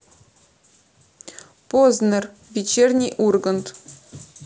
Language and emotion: Russian, neutral